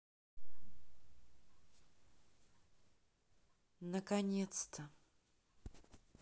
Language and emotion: Russian, sad